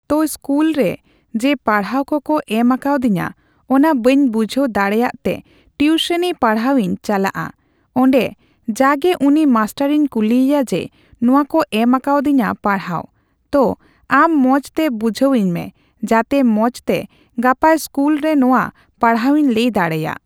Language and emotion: Santali, neutral